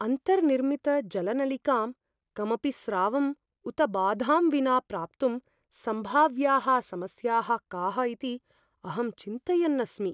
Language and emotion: Sanskrit, fearful